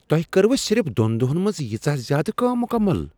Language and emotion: Kashmiri, surprised